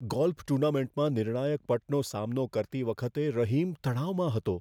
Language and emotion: Gujarati, fearful